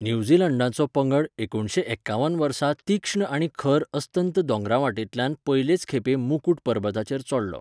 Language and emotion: Goan Konkani, neutral